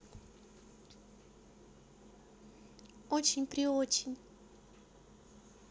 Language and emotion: Russian, positive